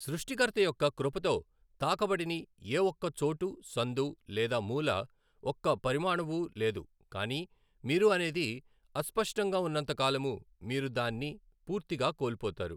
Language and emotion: Telugu, neutral